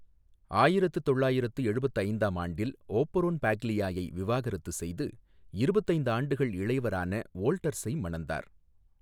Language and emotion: Tamil, neutral